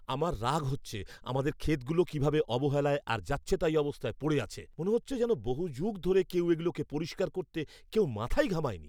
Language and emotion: Bengali, angry